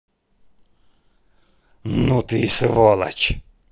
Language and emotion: Russian, angry